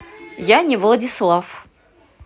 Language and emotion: Russian, positive